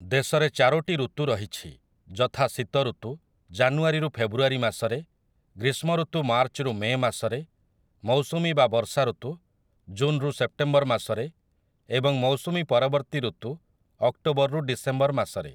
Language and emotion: Odia, neutral